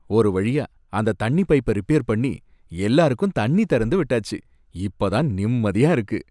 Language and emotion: Tamil, happy